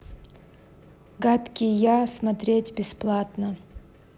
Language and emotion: Russian, neutral